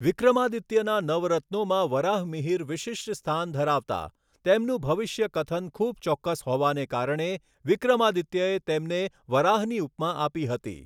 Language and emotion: Gujarati, neutral